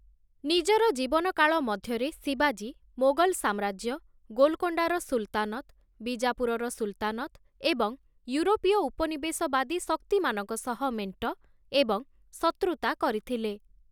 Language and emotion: Odia, neutral